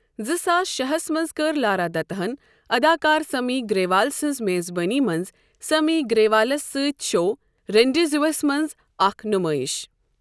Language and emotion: Kashmiri, neutral